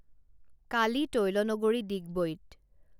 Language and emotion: Assamese, neutral